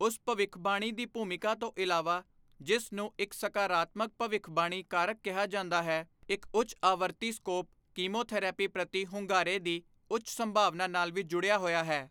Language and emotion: Punjabi, neutral